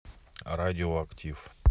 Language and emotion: Russian, neutral